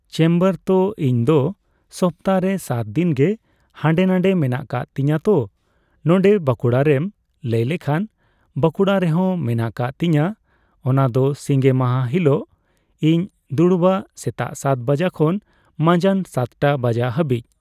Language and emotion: Santali, neutral